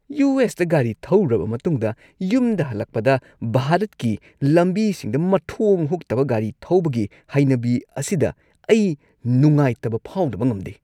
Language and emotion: Manipuri, disgusted